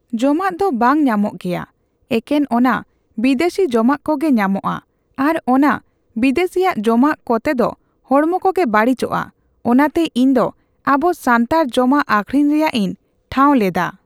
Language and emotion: Santali, neutral